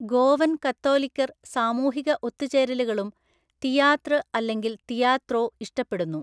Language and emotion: Malayalam, neutral